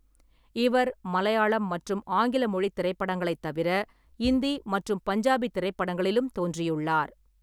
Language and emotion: Tamil, neutral